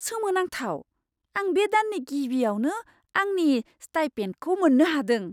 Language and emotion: Bodo, surprised